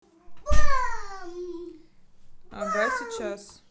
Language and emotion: Russian, neutral